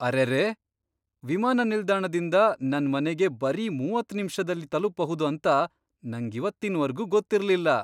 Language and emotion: Kannada, surprised